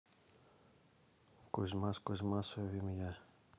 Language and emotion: Russian, neutral